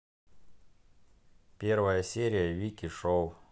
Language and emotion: Russian, neutral